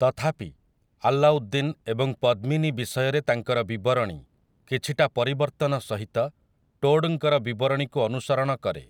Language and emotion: Odia, neutral